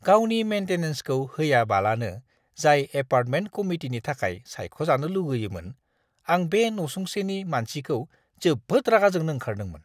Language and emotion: Bodo, disgusted